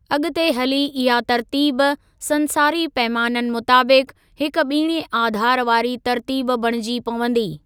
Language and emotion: Sindhi, neutral